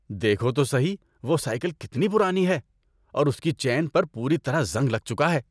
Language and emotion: Urdu, disgusted